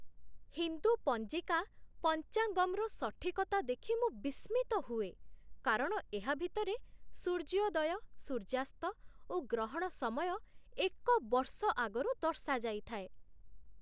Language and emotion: Odia, surprised